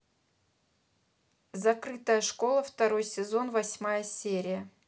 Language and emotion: Russian, neutral